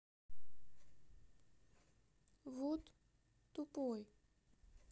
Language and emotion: Russian, neutral